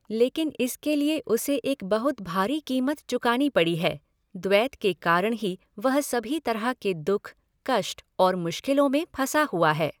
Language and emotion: Hindi, neutral